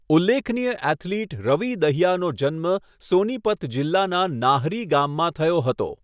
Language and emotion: Gujarati, neutral